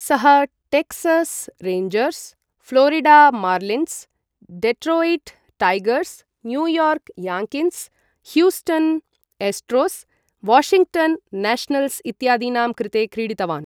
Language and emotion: Sanskrit, neutral